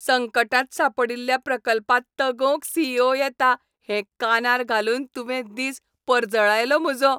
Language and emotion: Goan Konkani, happy